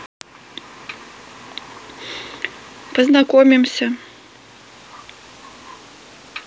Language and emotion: Russian, neutral